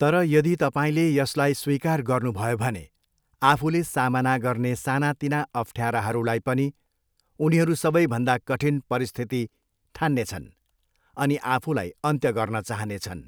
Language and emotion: Nepali, neutral